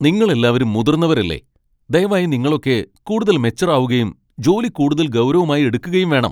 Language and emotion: Malayalam, angry